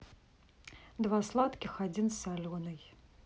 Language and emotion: Russian, neutral